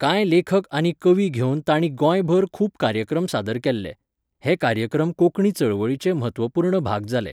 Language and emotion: Goan Konkani, neutral